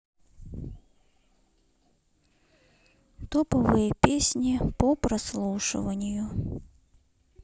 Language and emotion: Russian, sad